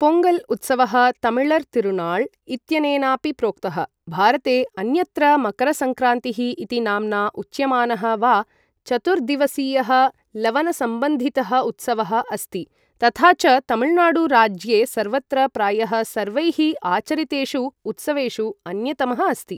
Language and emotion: Sanskrit, neutral